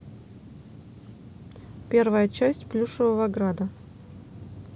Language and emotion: Russian, neutral